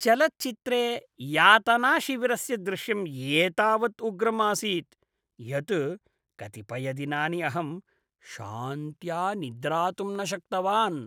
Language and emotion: Sanskrit, disgusted